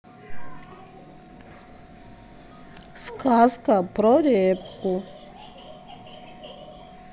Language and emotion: Russian, neutral